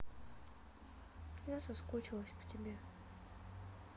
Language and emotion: Russian, sad